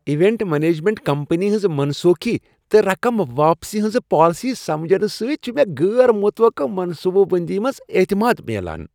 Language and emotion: Kashmiri, happy